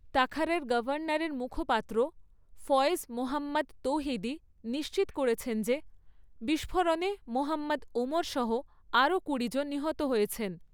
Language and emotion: Bengali, neutral